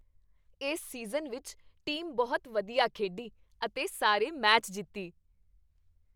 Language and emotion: Punjabi, happy